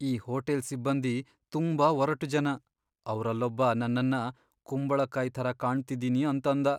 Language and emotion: Kannada, sad